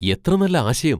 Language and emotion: Malayalam, surprised